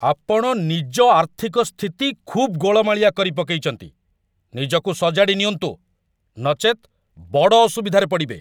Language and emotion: Odia, angry